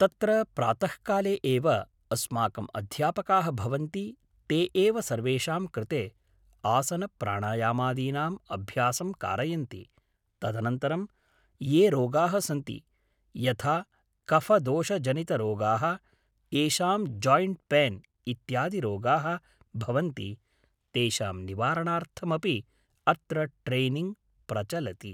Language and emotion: Sanskrit, neutral